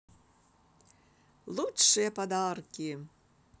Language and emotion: Russian, positive